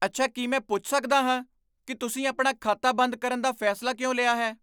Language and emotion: Punjabi, surprised